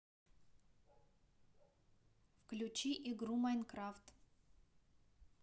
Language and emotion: Russian, neutral